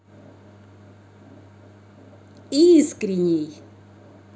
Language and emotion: Russian, positive